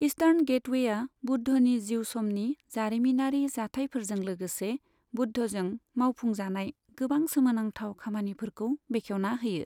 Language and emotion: Bodo, neutral